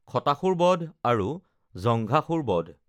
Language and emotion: Assamese, neutral